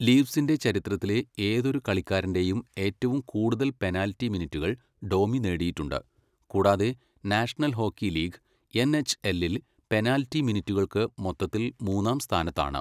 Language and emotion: Malayalam, neutral